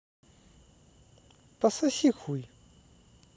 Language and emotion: Russian, neutral